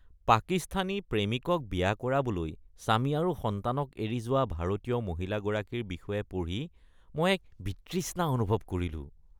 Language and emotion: Assamese, disgusted